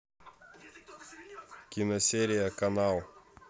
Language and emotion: Russian, neutral